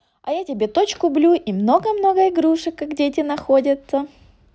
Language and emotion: Russian, positive